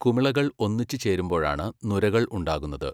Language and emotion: Malayalam, neutral